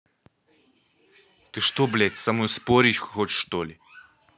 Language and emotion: Russian, angry